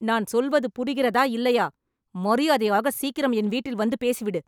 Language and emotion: Tamil, angry